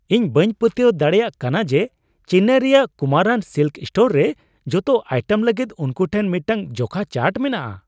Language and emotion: Santali, surprised